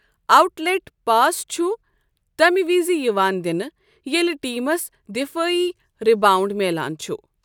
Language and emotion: Kashmiri, neutral